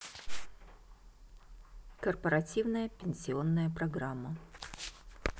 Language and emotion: Russian, neutral